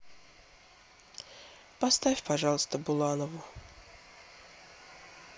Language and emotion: Russian, sad